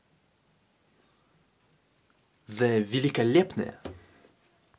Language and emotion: Russian, positive